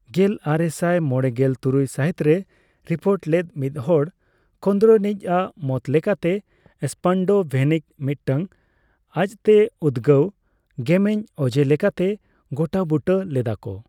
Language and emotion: Santali, neutral